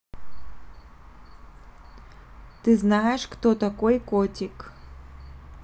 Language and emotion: Russian, neutral